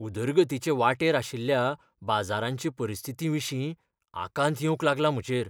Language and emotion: Goan Konkani, fearful